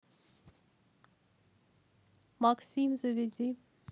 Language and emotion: Russian, neutral